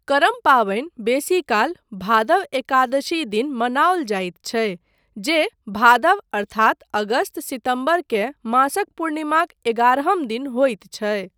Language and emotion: Maithili, neutral